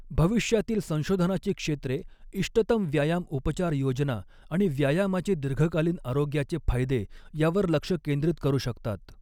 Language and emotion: Marathi, neutral